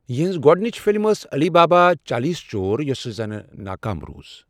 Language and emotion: Kashmiri, neutral